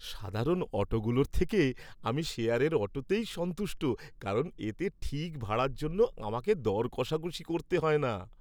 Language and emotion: Bengali, happy